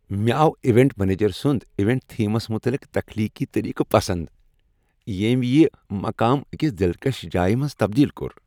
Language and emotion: Kashmiri, happy